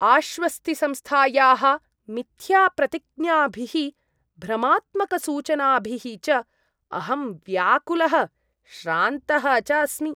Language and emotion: Sanskrit, disgusted